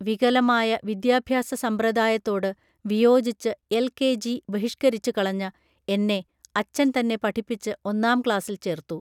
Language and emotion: Malayalam, neutral